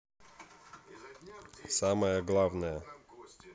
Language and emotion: Russian, neutral